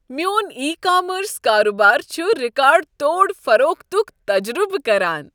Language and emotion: Kashmiri, happy